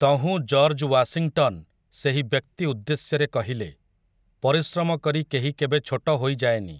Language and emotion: Odia, neutral